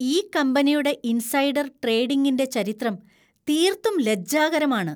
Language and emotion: Malayalam, disgusted